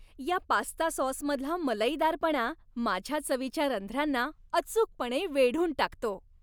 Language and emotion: Marathi, happy